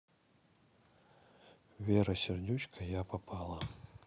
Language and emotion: Russian, neutral